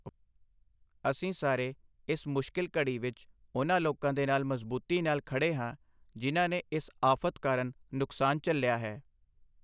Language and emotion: Punjabi, neutral